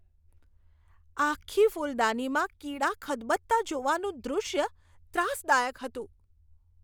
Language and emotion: Gujarati, disgusted